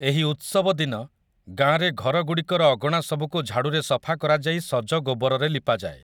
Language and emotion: Odia, neutral